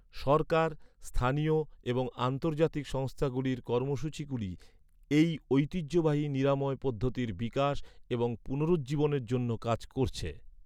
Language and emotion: Bengali, neutral